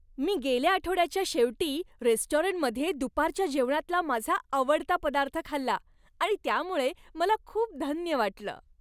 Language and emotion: Marathi, happy